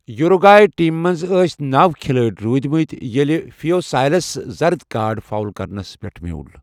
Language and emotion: Kashmiri, neutral